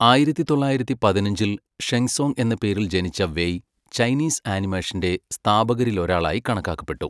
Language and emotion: Malayalam, neutral